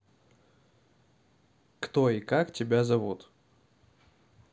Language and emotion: Russian, neutral